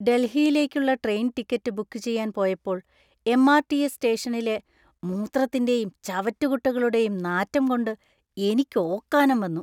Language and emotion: Malayalam, disgusted